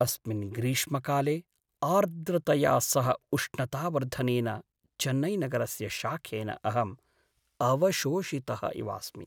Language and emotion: Sanskrit, sad